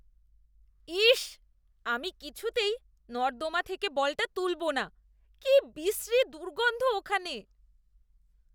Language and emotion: Bengali, disgusted